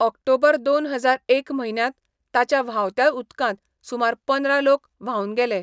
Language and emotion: Goan Konkani, neutral